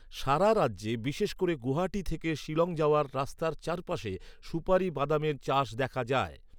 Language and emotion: Bengali, neutral